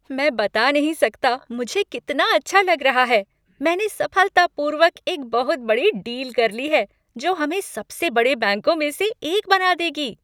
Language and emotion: Hindi, happy